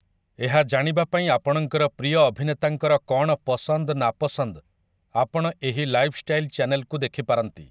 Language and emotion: Odia, neutral